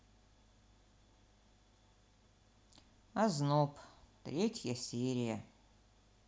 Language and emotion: Russian, neutral